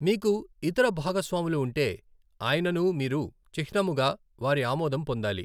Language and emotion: Telugu, neutral